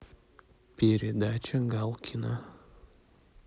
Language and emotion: Russian, neutral